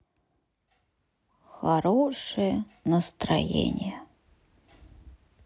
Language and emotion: Russian, sad